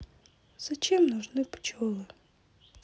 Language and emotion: Russian, sad